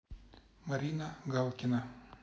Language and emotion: Russian, neutral